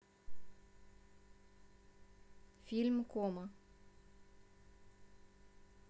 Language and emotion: Russian, neutral